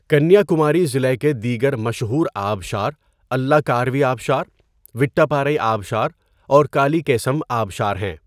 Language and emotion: Urdu, neutral